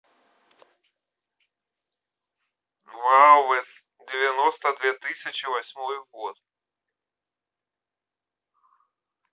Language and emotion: Russian, neutral